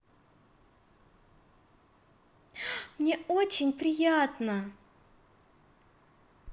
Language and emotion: Russian, positive